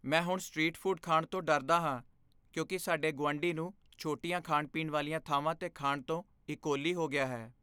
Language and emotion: Punjabi, fearful